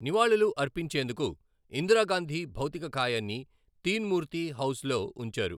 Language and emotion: Telugu, neutral